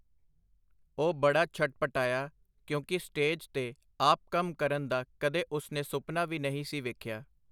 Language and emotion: Punjabi, neutral